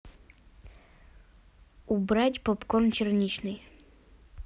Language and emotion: Russian, neutral